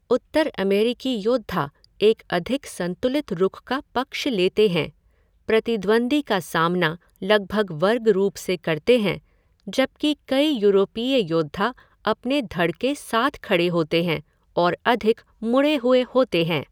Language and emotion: Hindi, neutral